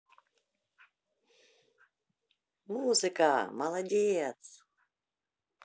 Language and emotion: Russian, positive